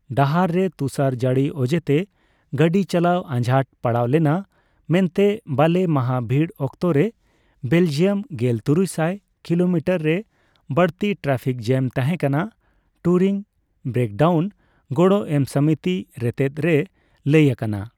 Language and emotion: Santali, neutral